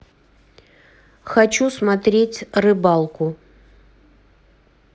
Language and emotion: Russian, neutral